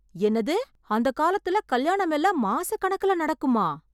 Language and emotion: Tamil, surprised